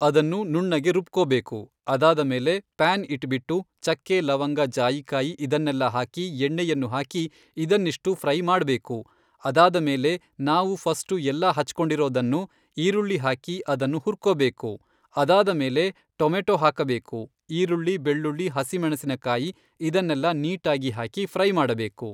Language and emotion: Kannada, neutral